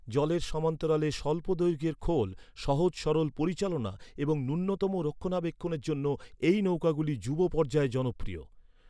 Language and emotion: Bengali, neutral